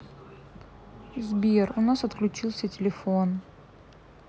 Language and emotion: Russian, sad